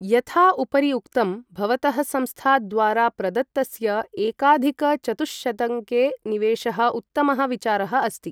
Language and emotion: Sanskrit, neutral